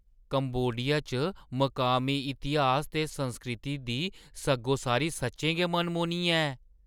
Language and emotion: Dogri, surprised